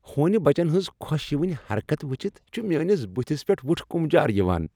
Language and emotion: Kashmiri, happy